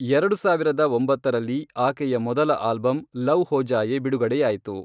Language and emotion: Kannada, neutral